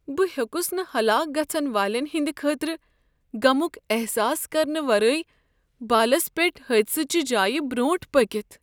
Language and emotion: Kashmiri, sad